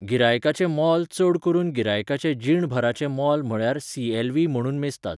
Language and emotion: Goan Konkani, neutral